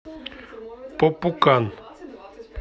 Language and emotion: Russian, neutral